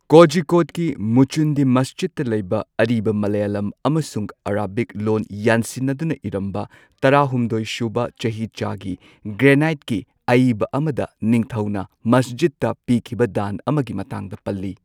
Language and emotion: Manipuri, neutral